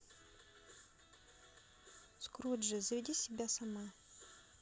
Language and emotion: Russian, neutral